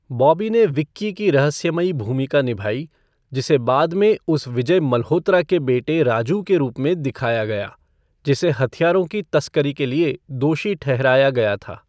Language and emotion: Hindi, neutral